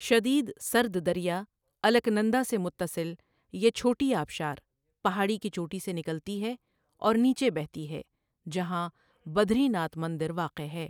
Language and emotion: Urdu, neutral